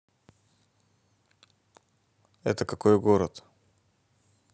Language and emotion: Russian, neutral